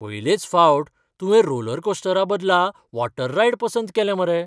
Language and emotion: Goan Konkani, surprised